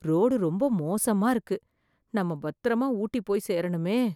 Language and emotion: Tamil, fearful